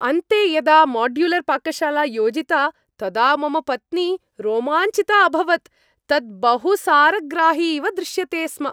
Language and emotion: Sanskrit, happy